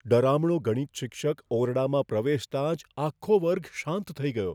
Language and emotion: Gujarati, fearful